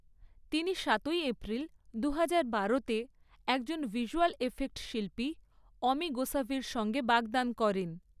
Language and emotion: Bengali, neutral